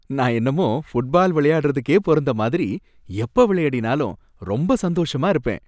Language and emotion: Tamil, happy